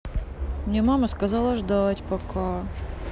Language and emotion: Russian, sad